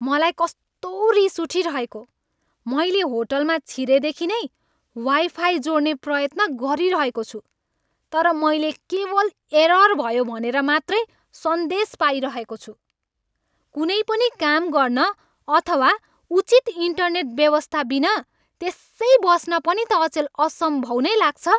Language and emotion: Nepali, angry